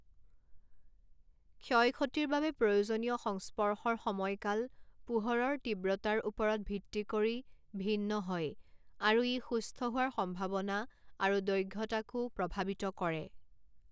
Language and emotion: Assamese, neutral